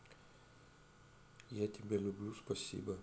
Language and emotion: Russian, neutral